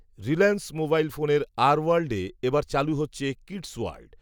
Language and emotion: Bengali, neutral